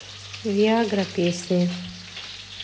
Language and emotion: Russian, neutral